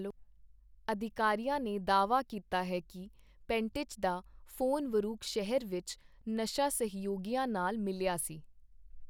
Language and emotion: Punjabi, neutral